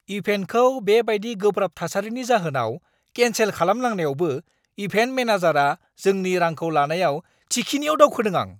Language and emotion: Bodo, angry